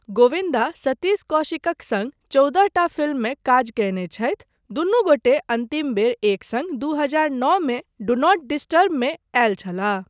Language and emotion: Maithili, neutral